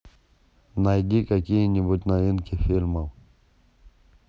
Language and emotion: Russian, neutral